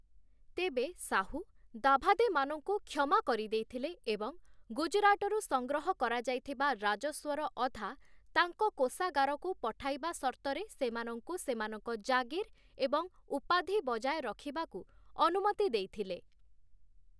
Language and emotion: Odia, neutral